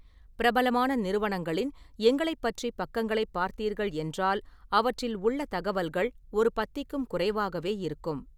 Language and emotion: Tamil, neutral